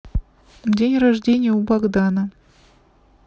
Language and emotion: Russian, neutral